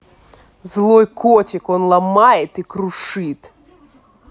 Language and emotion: Russian, angry